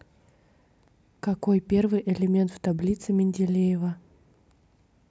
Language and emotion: Russian, neutral